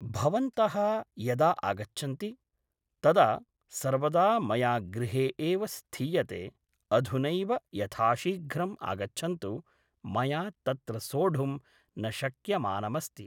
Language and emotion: Sanskrit, neutral